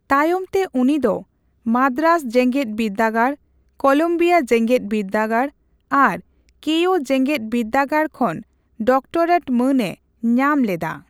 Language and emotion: Santali, neutral